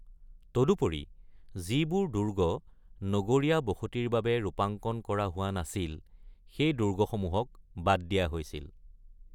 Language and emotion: Assamese, neutral